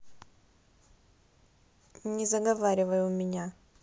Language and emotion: Russian, neutral